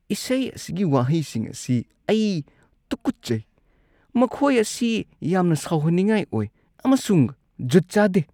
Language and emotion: Manipuri, disgusted